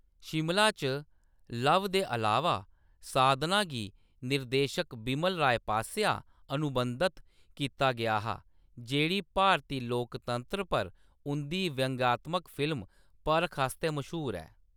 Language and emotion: Dogri, neutral